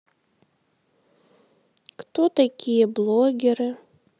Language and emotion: Russian, sad